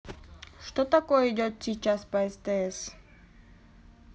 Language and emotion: Russian, neutral